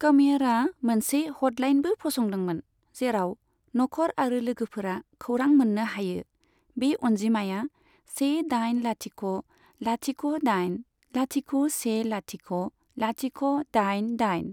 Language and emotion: Bodo, neutral